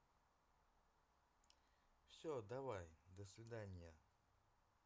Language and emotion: Russian, neutral